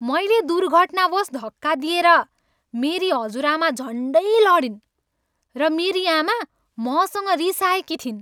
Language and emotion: Nepali, angry